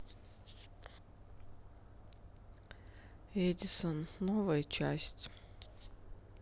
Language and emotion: Russian, sad